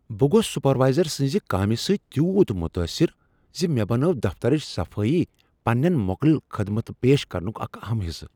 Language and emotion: Kashmiri, surprised